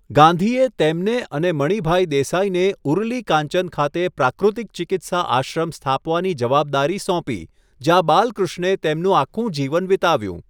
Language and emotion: Gujarati, neutral